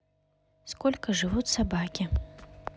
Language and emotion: Russian, neutral